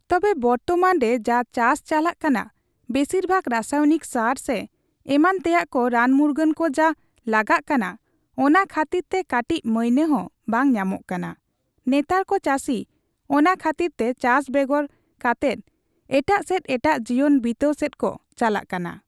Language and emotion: Santali, neutral